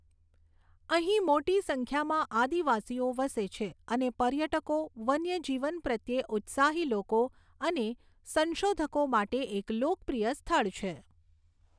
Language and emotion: Gujarati, neutral